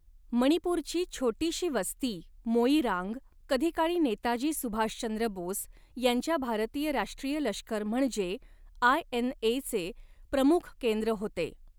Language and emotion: Marathi, neutral